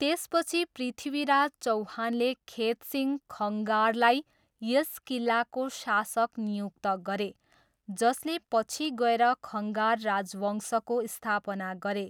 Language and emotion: Nepali, neutral